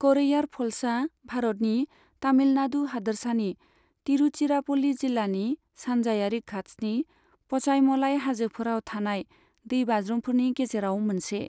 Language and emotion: Bodo, neutral